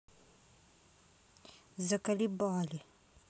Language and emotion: Russian, angry